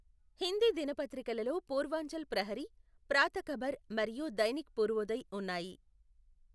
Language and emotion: Telugu, neutral